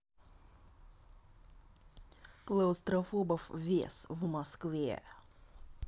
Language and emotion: Russian, angry